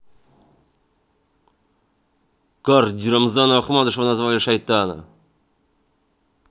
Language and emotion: Russian, angry